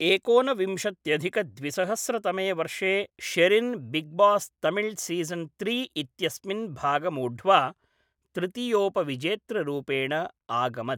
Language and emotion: Sanskrit, neutral